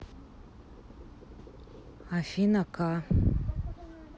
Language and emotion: Russian, neutral